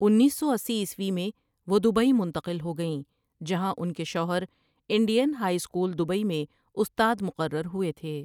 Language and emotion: Urdu, neutral